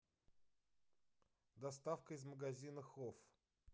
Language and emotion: Russian, neutral